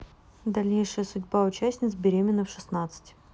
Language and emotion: Russian, neutral